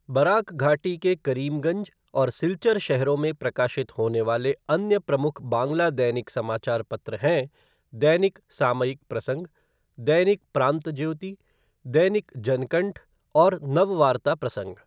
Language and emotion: Hindi, neutral